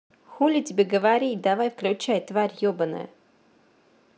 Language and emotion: Russian, neutral